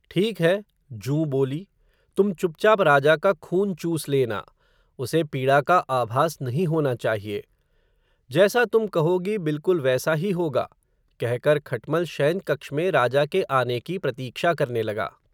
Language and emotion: Hindi, neutral